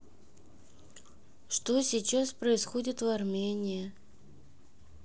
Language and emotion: Russian, neutral